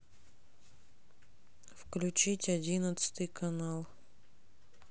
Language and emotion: Russian, neutral